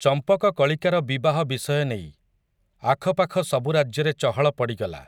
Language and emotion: Odia, neutral